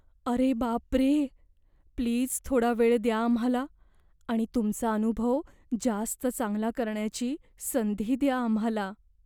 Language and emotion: Marathi, fearful